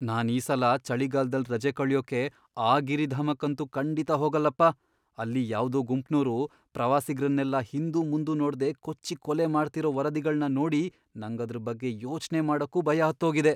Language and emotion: Kannada, fearful